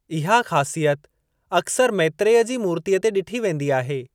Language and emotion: Sindhi, neutral